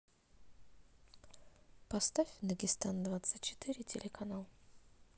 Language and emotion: Russian, neutral